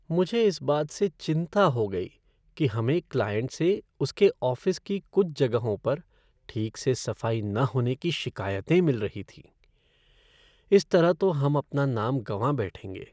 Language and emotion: Hindi, sad